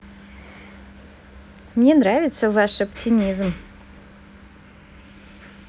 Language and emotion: Russian, positive